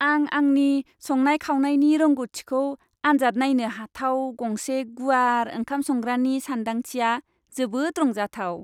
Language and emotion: Bodo, happy